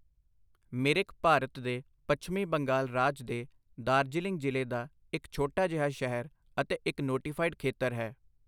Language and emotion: Punjabi, neutral